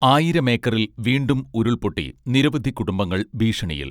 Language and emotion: Malayalam, neutral